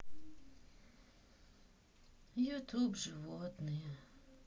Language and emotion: Russian, sad